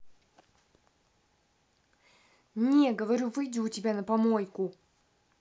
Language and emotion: Russian, angry